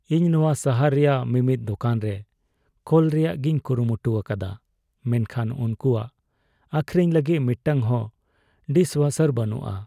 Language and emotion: Santali, sad